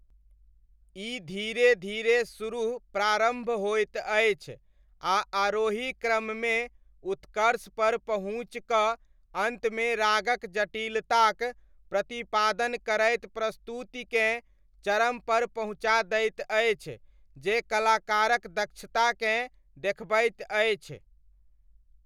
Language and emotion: Maithili, neutral